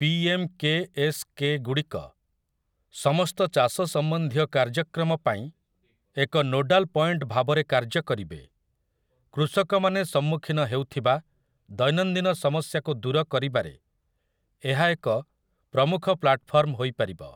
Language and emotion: Odia, neutral